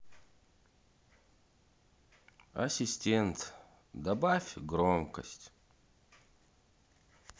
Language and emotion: Russian, sad